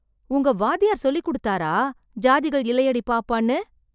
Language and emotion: Tamil, surprised